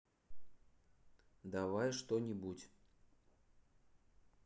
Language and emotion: Russian, neutral